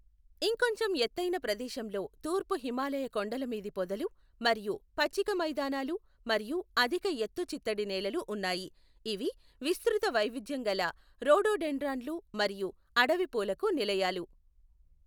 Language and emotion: Telugu, neutral